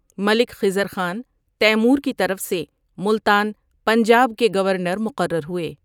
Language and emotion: Urdu, neutral